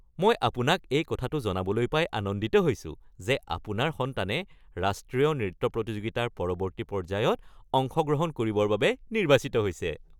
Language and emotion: Assamese, happy